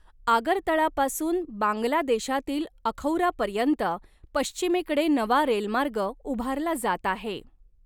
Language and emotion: Marathi, neutral